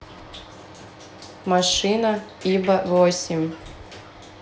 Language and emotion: Russian, neutral